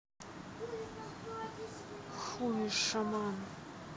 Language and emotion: Russian, angry